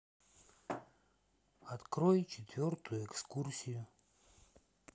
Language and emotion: Russian, neutral